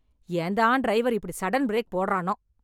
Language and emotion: Tamil, angry